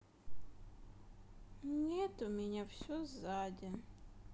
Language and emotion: Russian, sad